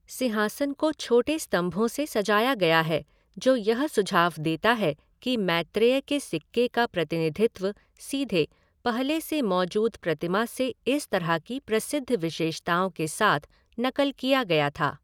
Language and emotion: Hindi, neutral